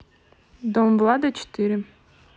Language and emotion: Russian, neutral